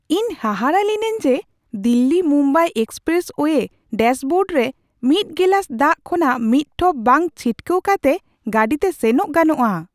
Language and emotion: Santali, surprised